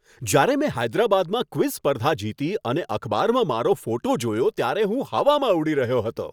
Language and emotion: Gujarati, happy